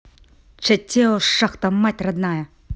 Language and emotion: Russian, angry